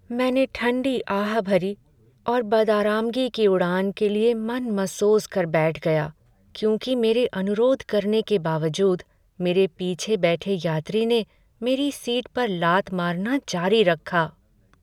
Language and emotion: Hindi, sad